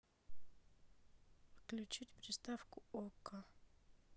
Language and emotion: Russian, neutral